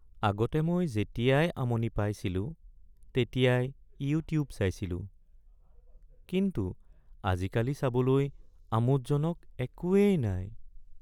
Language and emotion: Assamese, sad